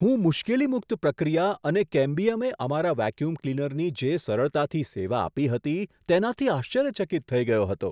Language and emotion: Gujarati, surprised